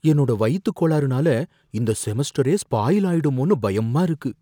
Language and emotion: Tamil, fearful